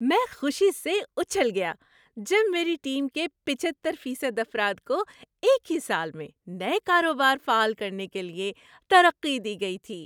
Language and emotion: Urdu, happy